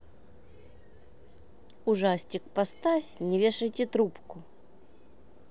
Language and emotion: Russian, neutral